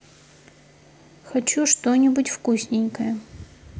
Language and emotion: Russian, neutral